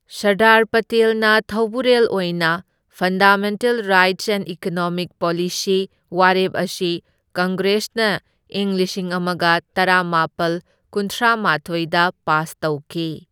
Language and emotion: Manipuri, neutral